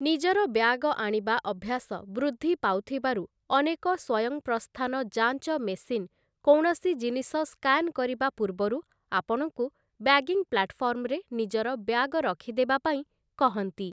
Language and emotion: Odia, neutral